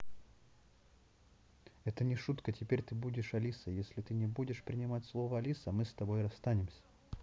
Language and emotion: Russian, neutral